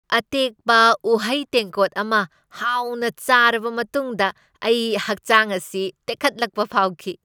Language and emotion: Manipuri, happy